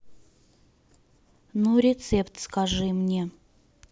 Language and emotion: Russian, neutral